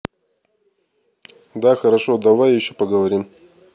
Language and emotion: Russian, neutral